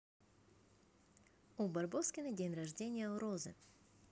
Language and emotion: Russian, positive